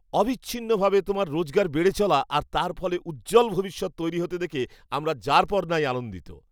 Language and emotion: Bengali, happy